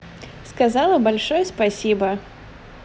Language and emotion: Russian, positive